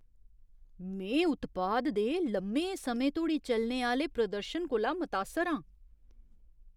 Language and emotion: Dogri, surprised